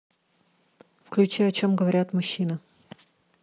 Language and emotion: Russian, neutral